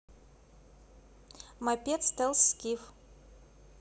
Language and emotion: Russian, neutral